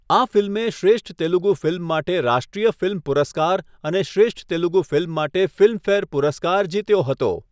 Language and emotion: Gujarati, neutral